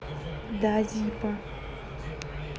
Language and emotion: Russian, neutral